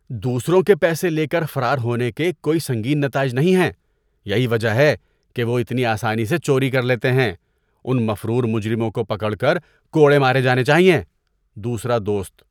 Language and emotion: Urdu, disgusted